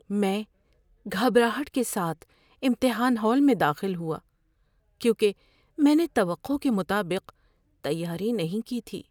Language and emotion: Urdu, fearful